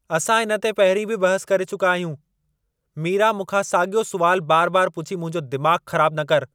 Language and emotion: Sindhi, angry